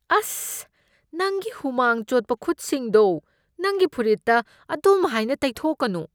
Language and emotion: Manipuri, disgusted